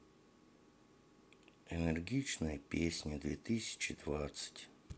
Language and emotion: Russian, sad